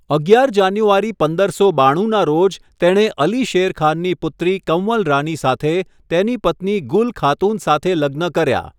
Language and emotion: Gujarati, neutral